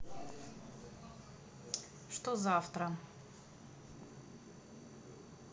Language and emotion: Russian, neutral